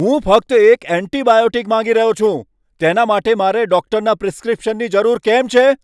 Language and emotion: Gujarati, angry